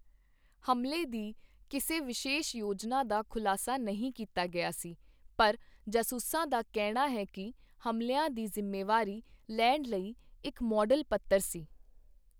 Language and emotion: Punjabi, neutral